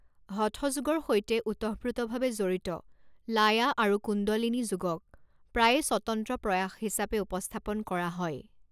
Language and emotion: Assamese, neutral